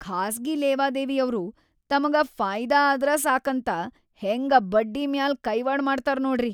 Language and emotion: Kannada, disgusted